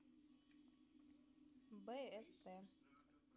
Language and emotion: Russian, neutral